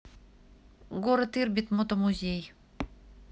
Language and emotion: Russian, neutral